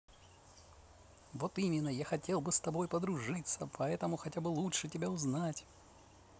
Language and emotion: Russian, positive